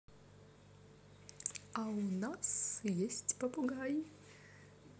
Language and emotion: Russian, positive